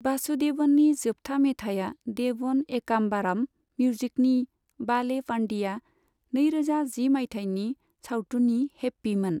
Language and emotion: Bodo, neutral